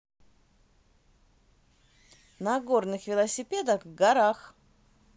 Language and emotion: Russian, positive